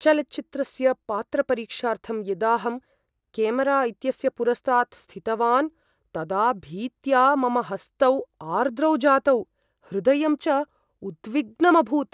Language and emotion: Sanskrit, fearful